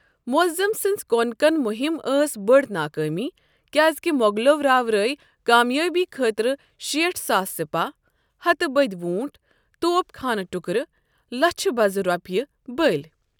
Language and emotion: Kashmiri, neutral